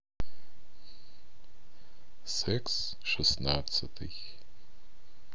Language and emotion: Russian, neutral